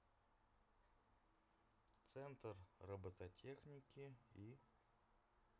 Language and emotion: Russian, neutral